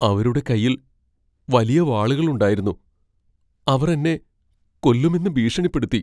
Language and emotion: Malayalam, fearful